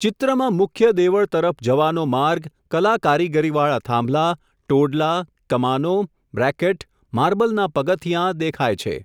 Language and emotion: Gujarati, neutral